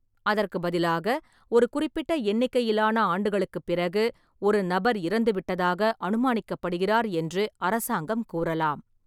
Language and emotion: Tamil, neutral